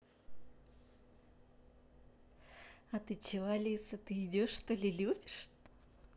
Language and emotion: Russian, positive